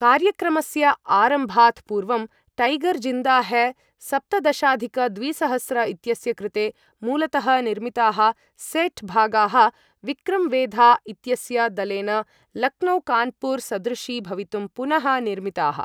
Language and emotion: Sanskrit, neutral